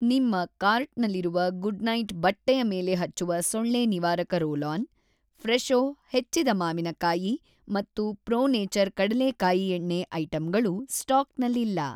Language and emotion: Kannada, neutral